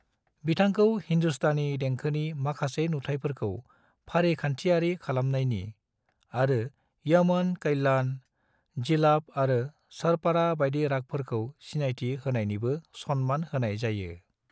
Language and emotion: Bodo, neutral